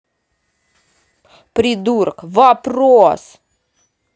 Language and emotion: Russian, angry